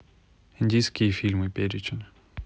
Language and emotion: Russian, neutral